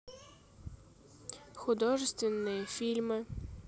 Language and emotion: Russian, neutral